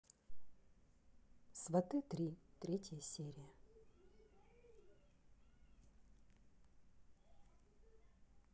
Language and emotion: Russian, neutral